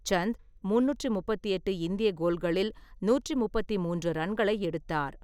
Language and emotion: Tamil, neutral